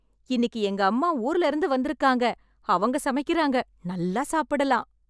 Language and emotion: Tamil, happy